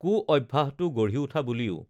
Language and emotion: Assamese, neutral